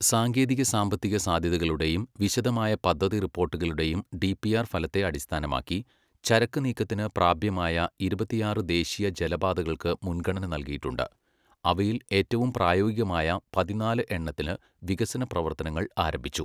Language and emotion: Malayalam, neutral